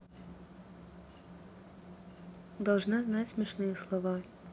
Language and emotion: Russian, neutral